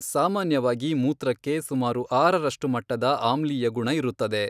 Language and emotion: Kannada, neutral